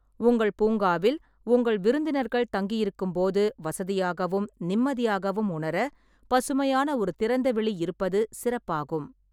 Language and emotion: Tamil, neutral